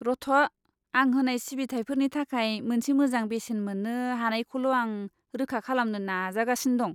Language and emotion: Bodo, disgusted